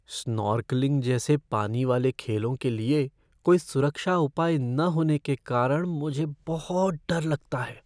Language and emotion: Hindi, fearful